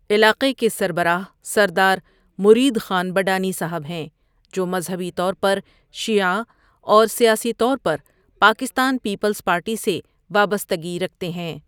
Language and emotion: Urdu, neutral